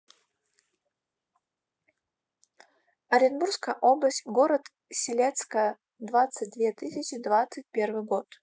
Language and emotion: Russian, neutral